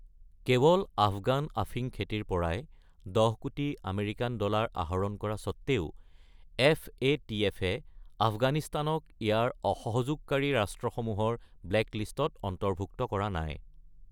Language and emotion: Assamese, neutral